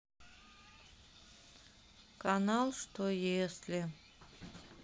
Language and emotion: Russian, sad